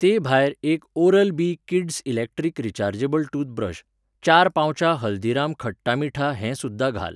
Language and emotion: Goan Konkani, neutral